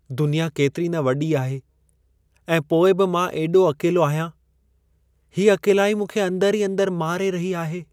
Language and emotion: Sindhi, sad